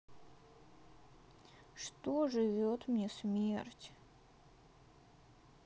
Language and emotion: Russian, sad